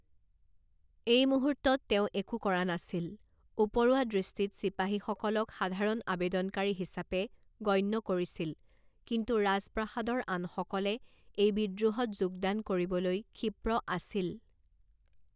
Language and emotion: Assamese, neutral